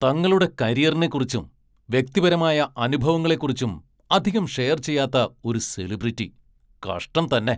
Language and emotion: Malayalam, angry